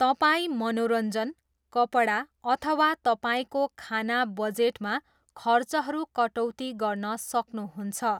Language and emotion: Nepali, neutral